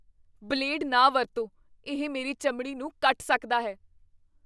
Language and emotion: Punjabi, fearful